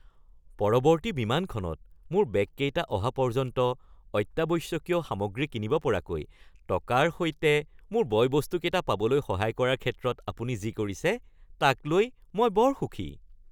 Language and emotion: Assamese, happy